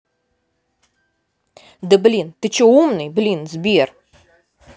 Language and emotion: Russian, angry